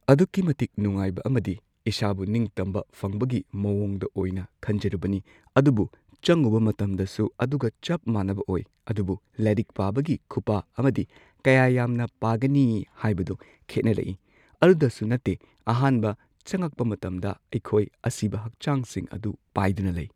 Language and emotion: Manipuri, neutral